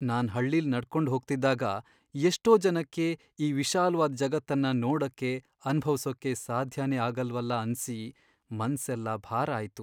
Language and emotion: Kannada, sad